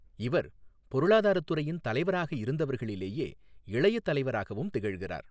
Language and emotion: Tamil, neutral